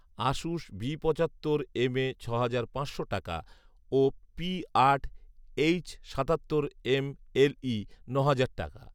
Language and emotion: Bengali, neutral